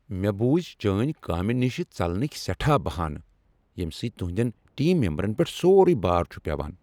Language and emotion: Kashmiri, angry